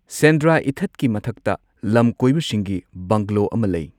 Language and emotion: Manipuri, neutral